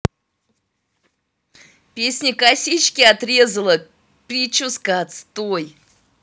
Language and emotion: Russian, positive